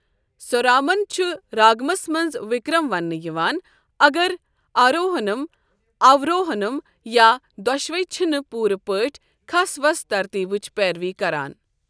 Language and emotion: Kashmiri, neutral